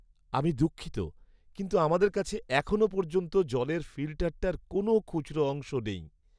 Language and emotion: Bengali, sad